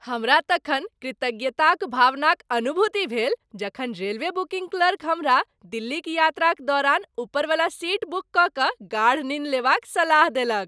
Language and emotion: Maithili, happy